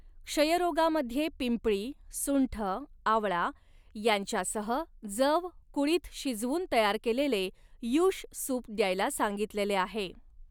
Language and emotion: Marathi, neutral